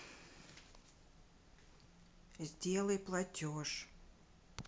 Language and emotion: Russian, neutral